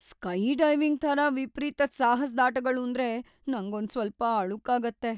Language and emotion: Kannada, fearful